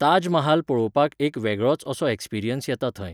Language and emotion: Goan Konkani, neutral